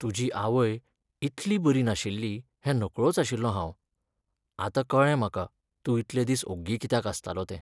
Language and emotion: Goan Konkani, sad